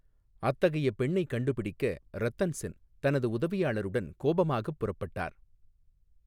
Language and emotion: Tamil, neutral